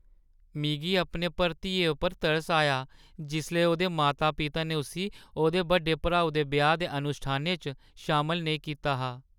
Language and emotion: Dogri, sad